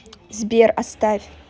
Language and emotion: Russian, neutral